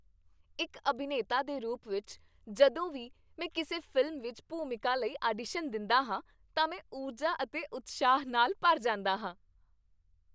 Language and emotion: Punjabi, happy